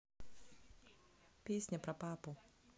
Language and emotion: Russian, neutral